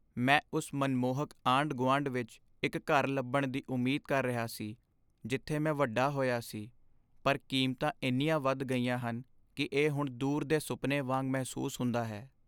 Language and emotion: Punjabi, sad